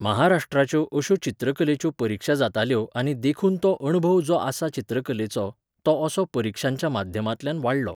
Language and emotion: Goan Konkani, neutral